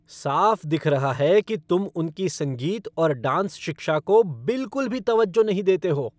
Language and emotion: Hindi, angry